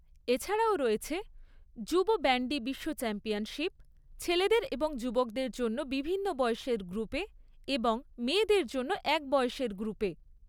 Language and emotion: Bengali, neutral